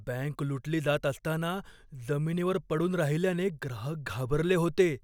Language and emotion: Marathi, fearful